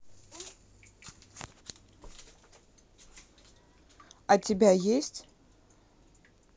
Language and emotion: Russian, neutral